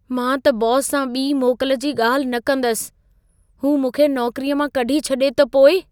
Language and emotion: Sindhi, fearful